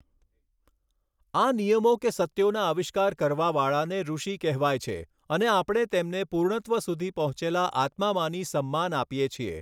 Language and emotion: Gujarati, neutral